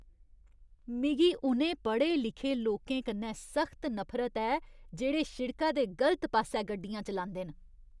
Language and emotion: Dogri, disgusted